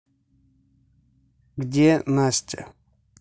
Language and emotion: Russian, neutral